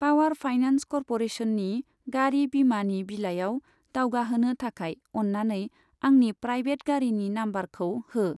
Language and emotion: Bodo, neutral